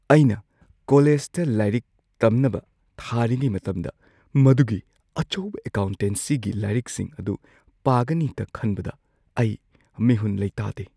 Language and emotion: Manipuri, fearful